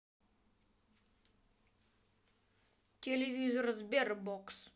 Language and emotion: Russian, neutral